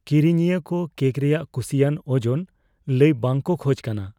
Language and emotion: Santali, fearful